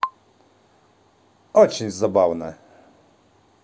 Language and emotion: Russian, positive